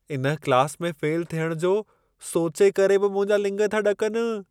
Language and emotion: Sindhi, fearful